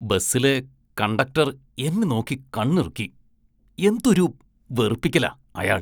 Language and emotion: Malayalam, disgusted